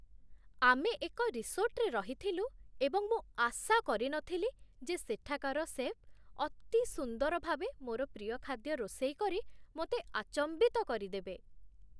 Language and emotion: Odia, surprised